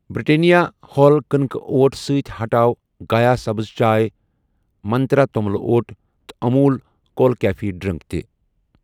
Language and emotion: Kashmiri, neutral